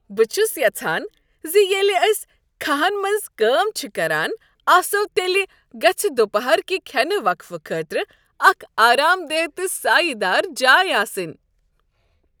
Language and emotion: Kashmiri, happy